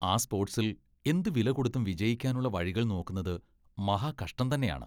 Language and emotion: Malayalam, disgusted